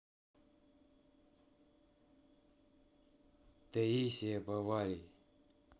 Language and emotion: Russian, neutral